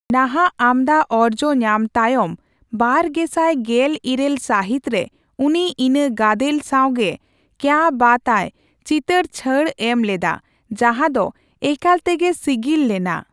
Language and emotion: Santali, neutral